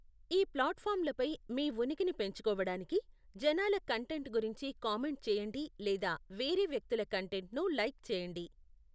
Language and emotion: Telugu, neutral